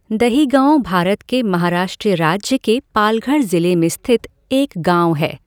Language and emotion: Hindi, neutral